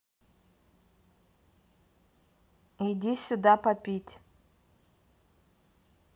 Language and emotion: Russian, neutral